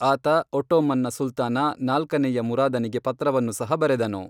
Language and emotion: Kannada, neutral